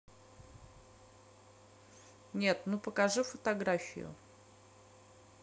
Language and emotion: Russian, neutral